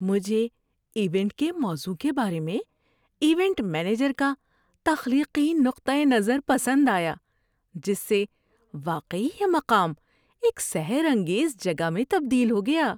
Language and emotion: Urdu, happy